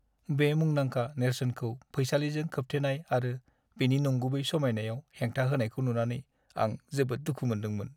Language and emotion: Bodo, sad